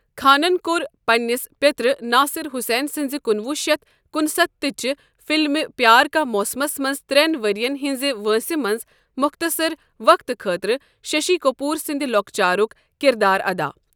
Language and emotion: Kashmiri, neutral